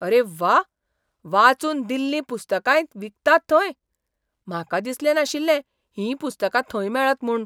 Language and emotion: Goan Konkani, surprised